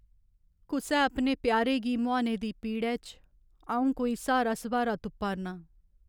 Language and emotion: Dogri, sad